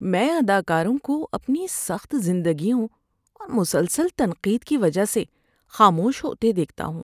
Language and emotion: Urdu, sad